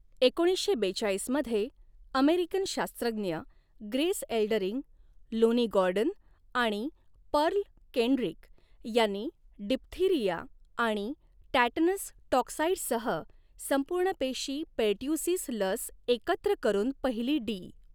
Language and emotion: Marathi, neutral